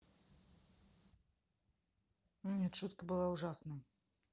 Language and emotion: Russian, neutral